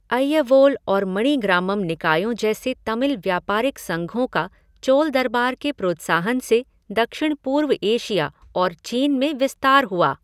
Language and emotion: Hindi, neutral